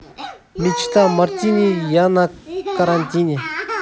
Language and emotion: Russian, neutral